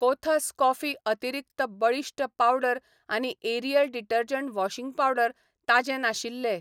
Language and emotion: Goan Konkani, neutral